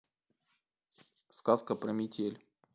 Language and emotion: Russian, neutral